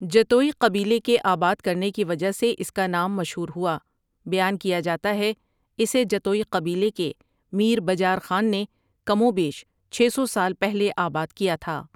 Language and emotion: Urdu, neutral